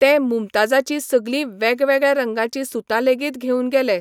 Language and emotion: Goan Konkani, neutral